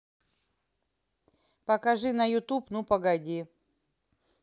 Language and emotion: Russian, neutral